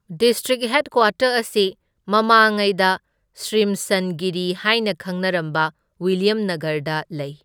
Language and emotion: Manipuri, neutral